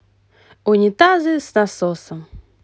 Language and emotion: Russian, positive